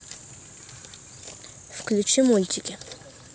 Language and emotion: Russian, neutral